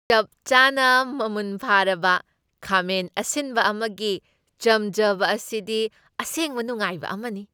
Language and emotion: Manipuri, happy